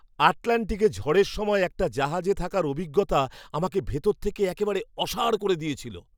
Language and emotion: Bengali, surprised